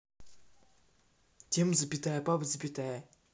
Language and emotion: Russian, neutral